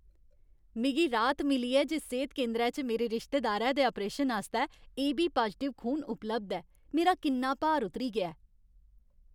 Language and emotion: Dogri, happy